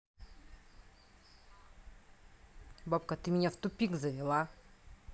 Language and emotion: Russian, angry